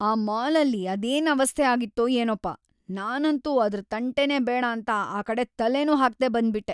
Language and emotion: Kannada, disgusted